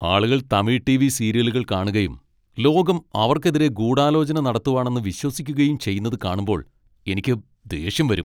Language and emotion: Malayalam, angry